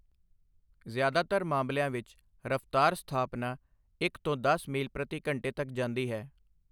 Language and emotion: Punjabi, neutral